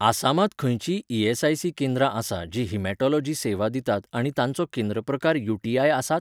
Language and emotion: Goan Konkani, neutral